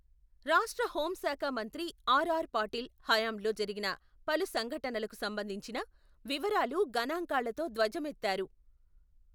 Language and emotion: Telugu, neutral